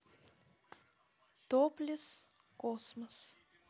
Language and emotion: Russian, neutral